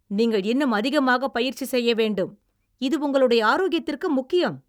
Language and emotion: Tamil, angry